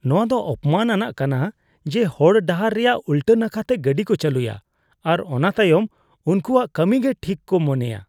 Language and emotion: Santali, disgusted